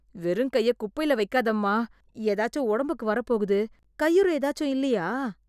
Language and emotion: Tamil, disgusted